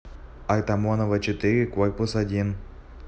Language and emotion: Russian, neutral